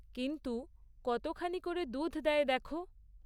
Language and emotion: Bengali, neutral